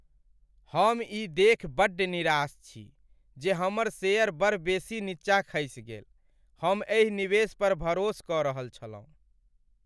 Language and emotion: Maithili, sad